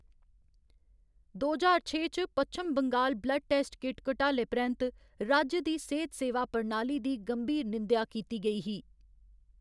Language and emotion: Dogri, neutral